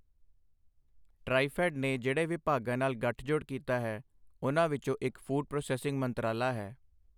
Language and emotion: Punjabi, neutral